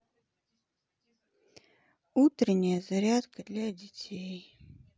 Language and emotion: Russian, sad